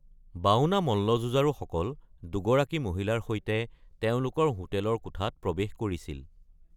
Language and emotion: Assamese, neutral